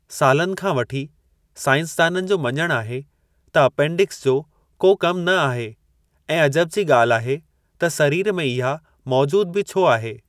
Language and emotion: Sindhi, neutral